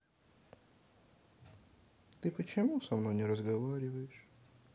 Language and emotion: Russian, sad